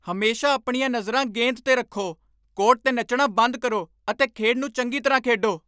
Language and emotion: Punjabi, angry